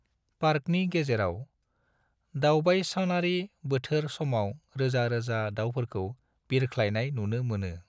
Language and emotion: Bodo, neutral